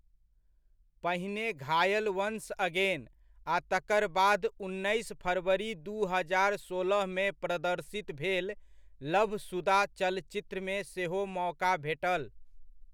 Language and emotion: Maithili, neutral